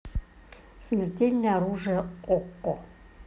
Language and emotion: Russian, neutral